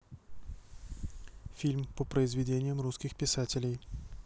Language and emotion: Russian, neutral